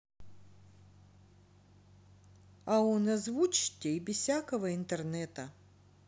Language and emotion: Russian, neutral